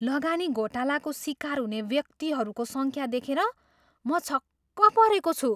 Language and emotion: Nepali, surprised